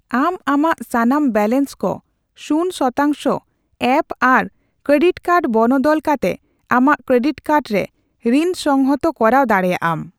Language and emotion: Santali, neutral